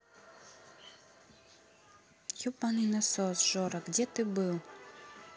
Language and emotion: Russian, angry